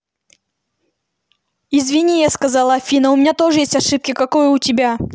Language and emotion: Russian, angry